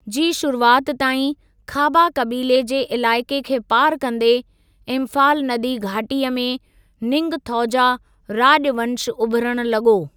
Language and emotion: Sindhi, neutral